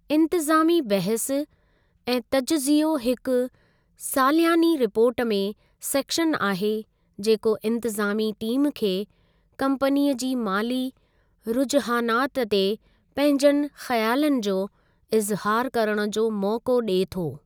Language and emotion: Sindhi, neutral